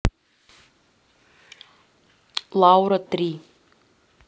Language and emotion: Russian, neutral